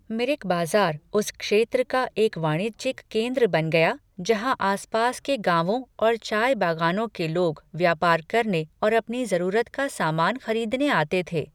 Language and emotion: Hindi, neutral